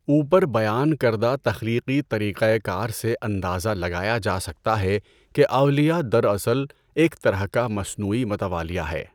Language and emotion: Urdu, neutral